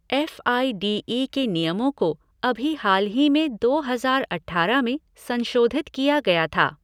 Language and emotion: Hindi, neutral